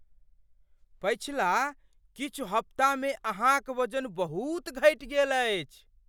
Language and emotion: Maithili, surprised